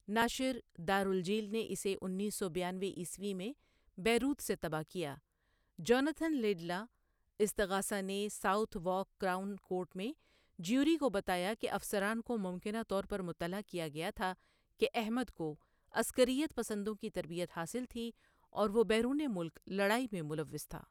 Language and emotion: Urdu, neutral